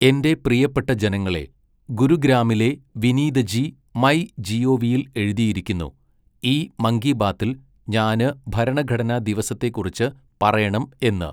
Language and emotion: Malayalam, neutral